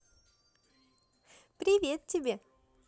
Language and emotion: Russian, positive